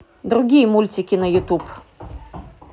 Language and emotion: Russian, neutral